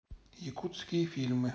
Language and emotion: Russian, neutral